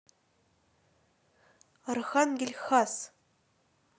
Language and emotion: Russian, neutral